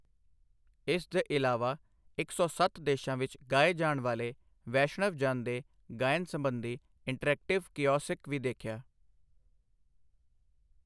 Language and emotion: Punjabi, neutral